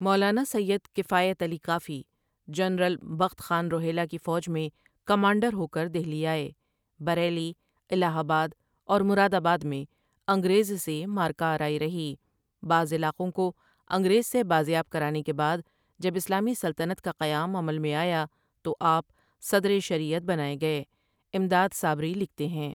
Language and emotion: Urdu, neutral